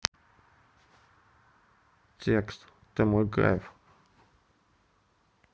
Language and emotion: Russian, neutral